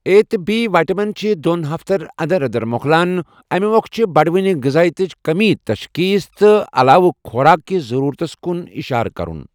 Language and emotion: Kashmiri, neutral